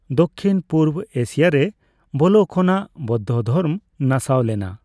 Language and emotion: Santali, neutral